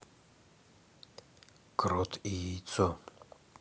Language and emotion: Russian, neutral